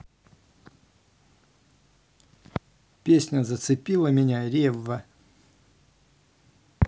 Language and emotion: Russian, neutral